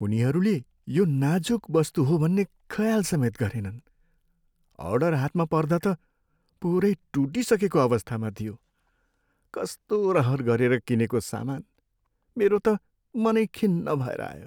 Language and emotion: Nepali, sad